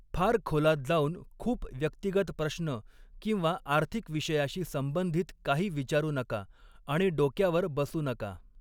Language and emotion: Marathi, neutral